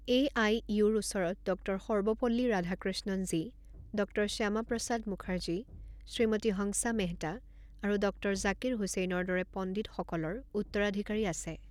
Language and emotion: Assamese, neutral